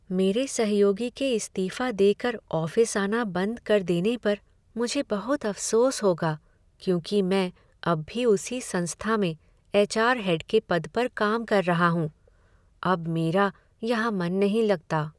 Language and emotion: Hindi, sad